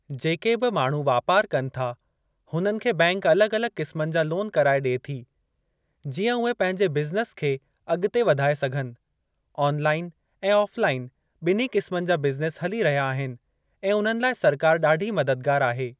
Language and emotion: Sindhi, neutral